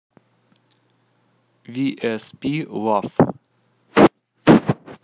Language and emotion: Russian, neutral